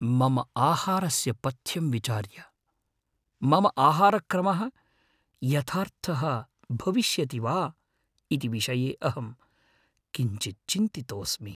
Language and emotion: Sanskrit, fearful